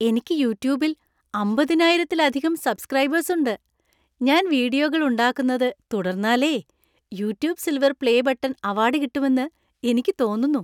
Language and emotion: Malayalam, happy